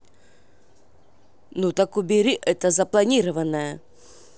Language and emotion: Russian, angry